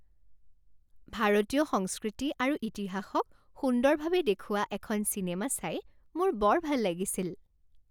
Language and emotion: Assamese, happy